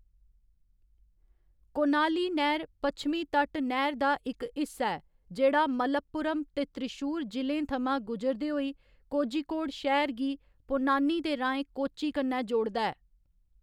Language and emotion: Dogri, neutral